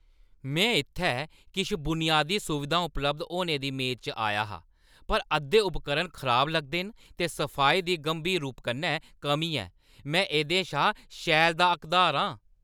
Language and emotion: Dogri, angry